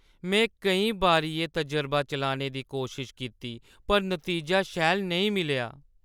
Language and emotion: Dogri, sad